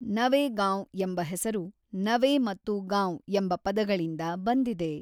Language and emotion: Kannada, neutral